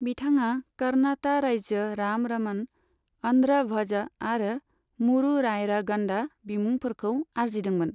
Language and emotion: Bodo, neutral